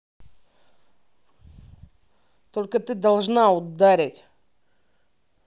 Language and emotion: Russian, angry